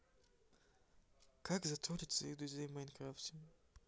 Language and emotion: Russian, sad